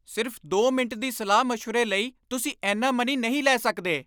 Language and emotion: Punjabi, angry